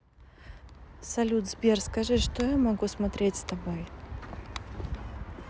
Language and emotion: Russian, neutral